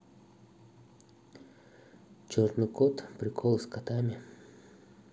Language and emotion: Russian, neutral